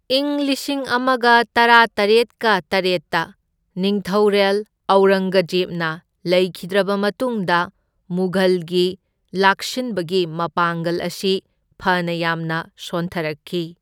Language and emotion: Manipuri, neutral